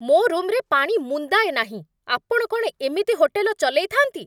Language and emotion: Odia, angry